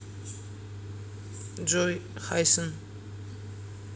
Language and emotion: Russian, neutral